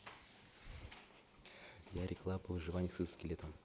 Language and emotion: Russian, neutral